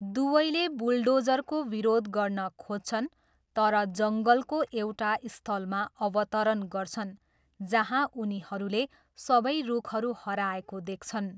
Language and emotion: Nepali, neutral